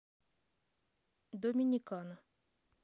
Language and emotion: Russian, neutral